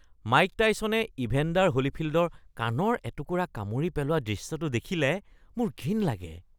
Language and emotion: Assamese, disgusted